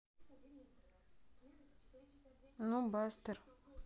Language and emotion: Russian, neutral